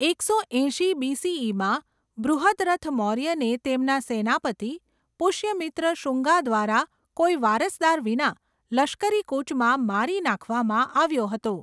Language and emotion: Gujarati, neutral